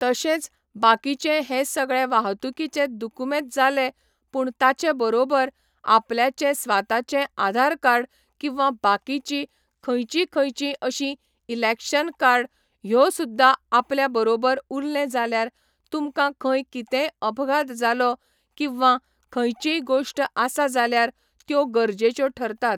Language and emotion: Goan Konkani, neutral